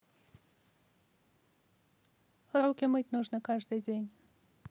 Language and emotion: Russian, neutral